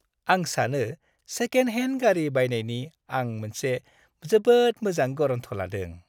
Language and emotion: Bodo, happy